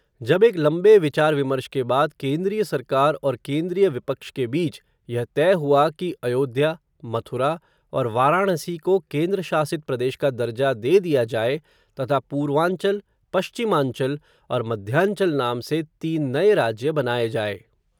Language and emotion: Hindi, neutral